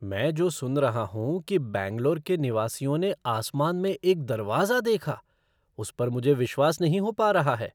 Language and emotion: Hindi, surprised